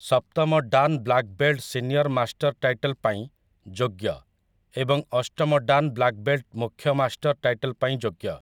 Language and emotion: Odia, neutral